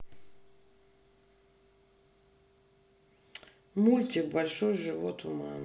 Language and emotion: Russian, neutral